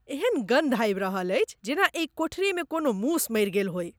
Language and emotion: Maithili, disgusted